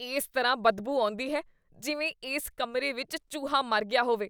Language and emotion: Punjabi, disgusted